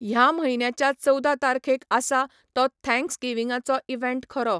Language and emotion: Goan Konkani, neutral